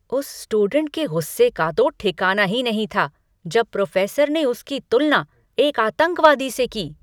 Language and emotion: Hindi, angry